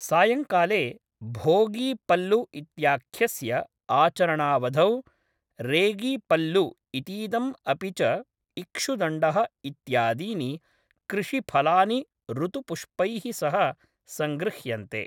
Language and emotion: Sanskrit, neutral